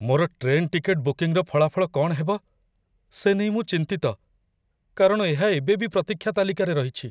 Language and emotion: Odia, fearful